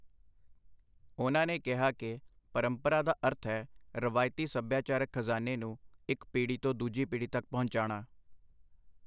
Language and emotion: Punjabi, neutral